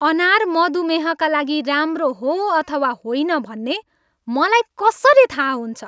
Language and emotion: Nepali, angry